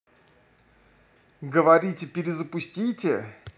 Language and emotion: Russian, neutral